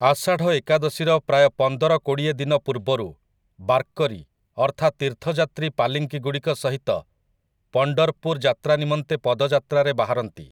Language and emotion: Odia, neutral